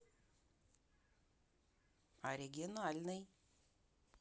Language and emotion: Russian, neutral